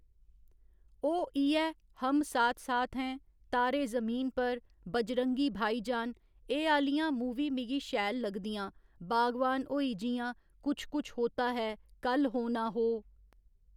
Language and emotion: Dogri, neutral